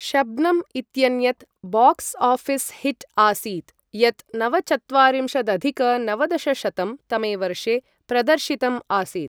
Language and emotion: Sanskrit, neutral